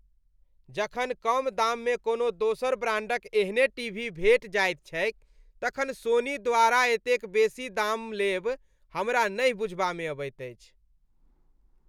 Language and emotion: Maithili, disgusted